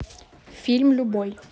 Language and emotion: Russian, neutral